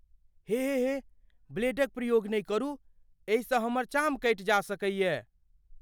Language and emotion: Maithili, fearful